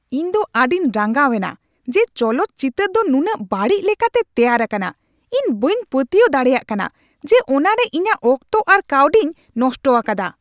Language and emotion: Santali, angry